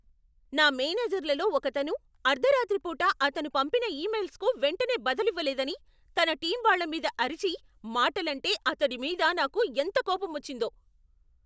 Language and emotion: Telugu, angry